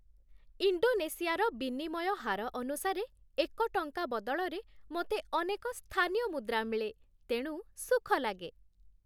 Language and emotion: Odia, happy